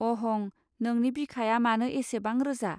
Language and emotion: Bodo, neutral